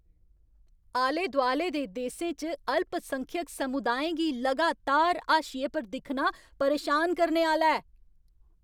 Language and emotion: Dogri, angry